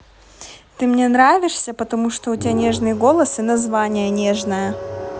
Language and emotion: Russian, neutral